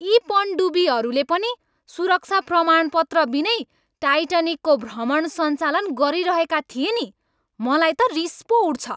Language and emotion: Nepali, angry